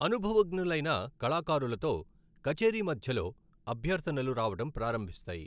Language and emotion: Telugu, neutral